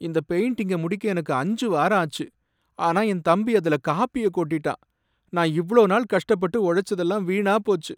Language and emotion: Tamil, sad